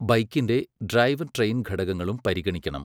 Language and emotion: Malayalam, neutral